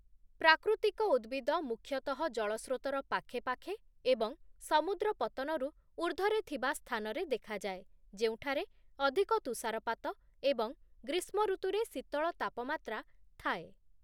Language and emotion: Odia, neutral